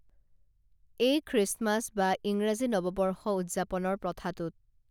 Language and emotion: Assamese, neutral